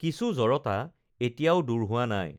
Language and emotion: Assamese, neutral